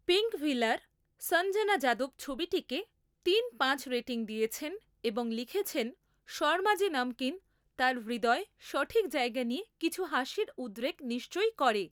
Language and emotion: Bengali, neutral